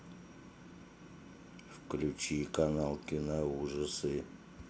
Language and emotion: Russian, neutral